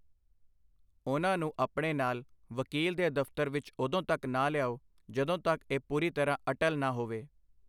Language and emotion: Punjabi, neutral